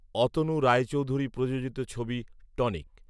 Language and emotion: Bengali, neutral